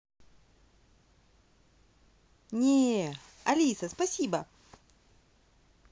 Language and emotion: Russian, positive